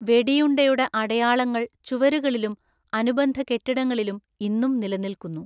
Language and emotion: Malayalam, neutral